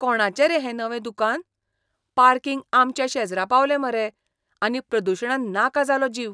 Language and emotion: Goan Konkani, disgusted